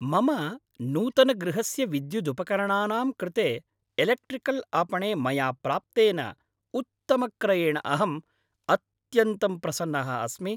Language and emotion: Sanskrit, happy